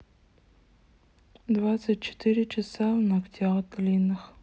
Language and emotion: Russian, sad